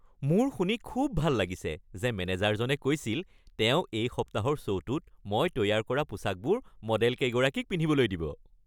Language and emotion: Assamese, happy